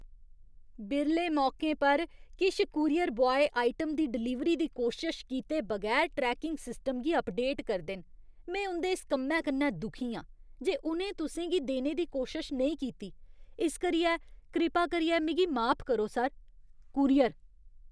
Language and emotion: Dogri, disgusted